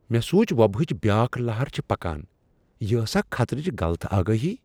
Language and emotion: Kashmiri, surprised